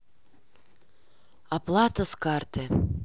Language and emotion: Russian, sad